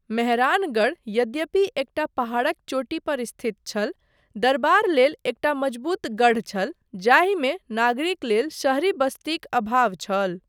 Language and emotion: Maithili, neutral